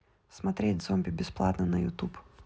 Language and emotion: Russian, neutral